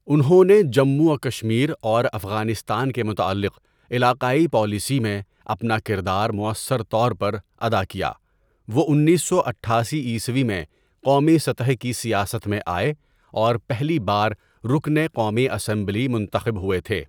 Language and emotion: Urdu, neutral